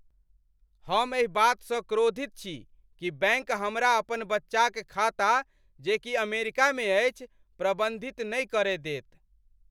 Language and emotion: Maithili, angry